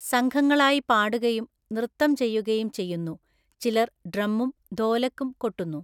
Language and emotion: Malayalam, neutral